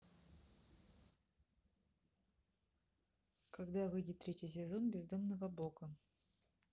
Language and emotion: Russian, neutral